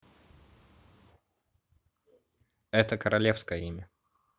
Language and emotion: Russian, neutral